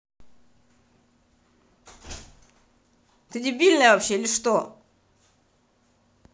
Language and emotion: Russian, angry